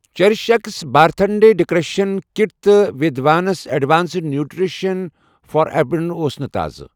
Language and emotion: Kashmiri, neutral